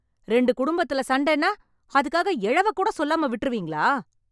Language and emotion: Tamil, angry